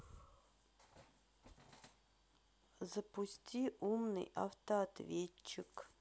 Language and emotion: Russian, neutral